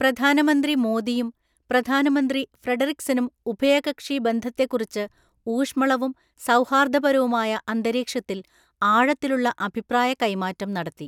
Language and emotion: Malayalam, neutral